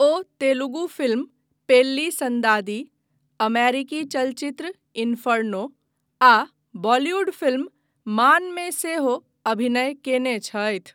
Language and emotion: Maithili, neutral